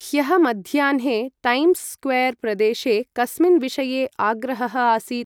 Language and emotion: Sanskrit, neutral